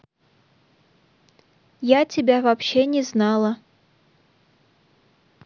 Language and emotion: Russian, neutral